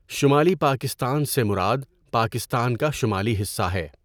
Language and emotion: Urdu, neutral